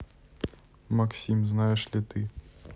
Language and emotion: Russian, neutral